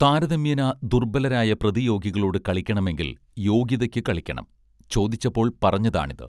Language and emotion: Malayalam, neutral